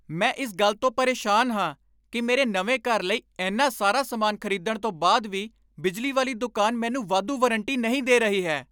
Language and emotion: Punjabi, angry